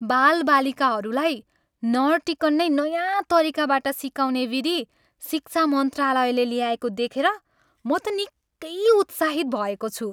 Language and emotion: Nepali, happy